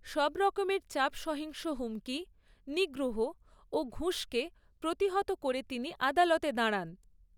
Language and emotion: Bengali, neutral